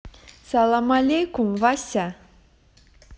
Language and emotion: Russian, positive